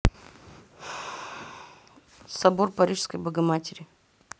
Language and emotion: Russian, neutral